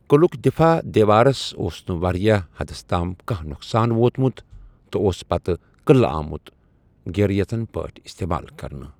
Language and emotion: Kashmiri, neutral